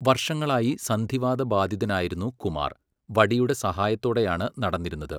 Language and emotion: Malayalam, neutral